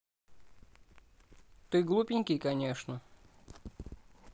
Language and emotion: Russian, neutral